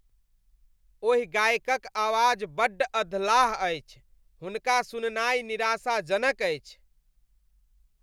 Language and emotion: Maithili, disgusted